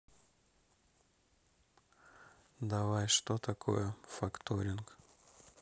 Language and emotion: Russian, neutral